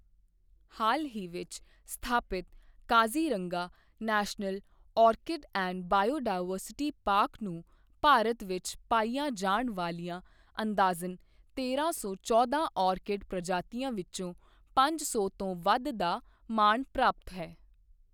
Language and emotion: Punjabi, neutral